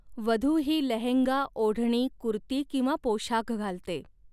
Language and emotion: Marathi, neutral